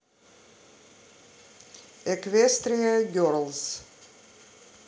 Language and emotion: Russian, neutral